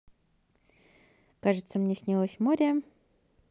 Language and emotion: Russian, positive